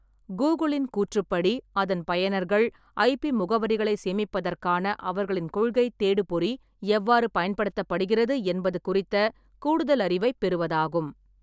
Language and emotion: Tamil, neutral